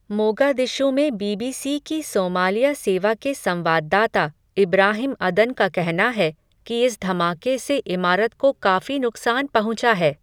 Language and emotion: Hindi, neutral